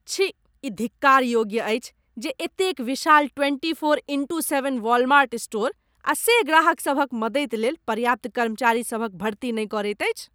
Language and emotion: Maithili, disgusted